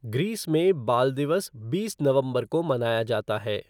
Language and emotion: Hindi, neutral